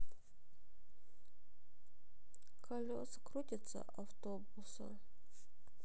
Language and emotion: Russian, sad